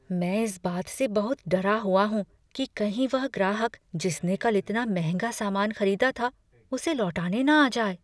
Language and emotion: Hindi, fearful